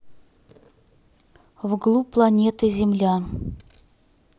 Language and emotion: Russian, neutral